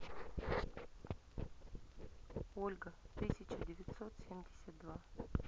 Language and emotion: Russian, neutral